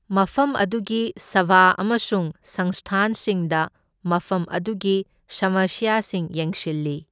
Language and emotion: Manipuri, neutral